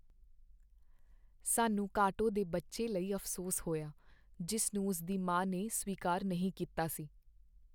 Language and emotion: Punjabi, sad